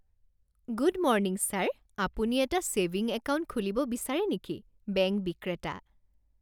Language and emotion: Assamese, happy